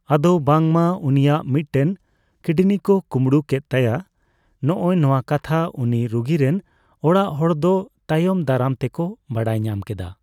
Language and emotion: Santali, neutral